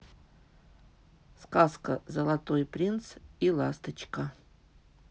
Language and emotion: Russian, neutral